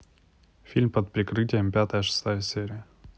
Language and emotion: Russian, neutral